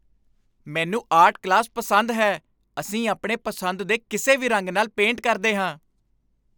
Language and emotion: Punjabi, happy